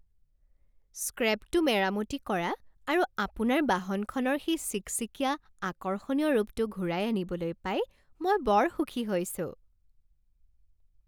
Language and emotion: Assamese, happy